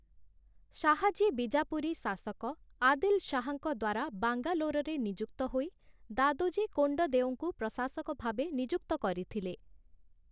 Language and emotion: Odia, neutral